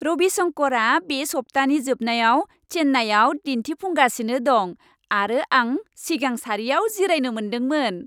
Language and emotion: Bodo, happy